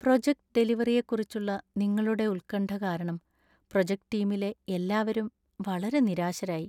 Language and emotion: Malayalam, sad